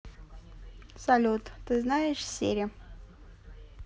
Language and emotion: Russian, neutral